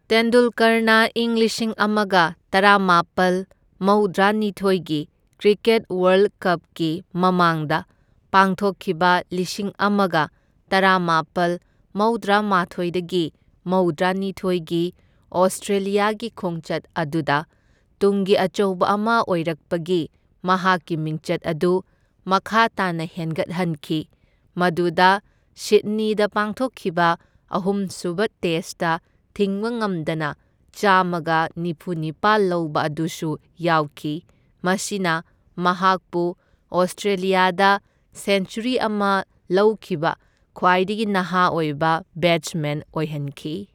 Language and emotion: Manipuri, neutral